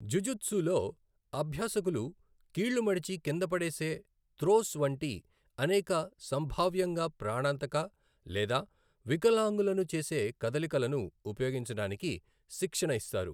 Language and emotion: Telugu, neutral